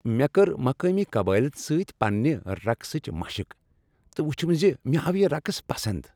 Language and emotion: Kashmiri, happy